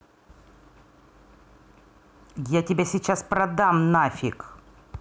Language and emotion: Russian, angry